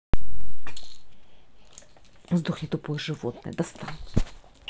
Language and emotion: Russian, angry